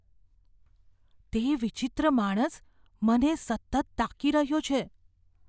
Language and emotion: Gujarati, fearful